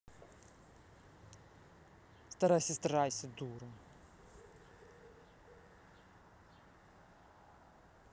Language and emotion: Russian, angry